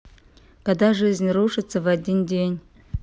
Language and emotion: Russian, neutral